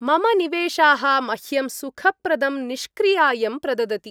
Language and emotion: Sanskrit, happy